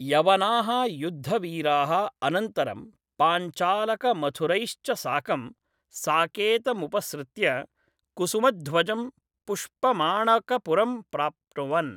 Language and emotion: Sanskrit, neutral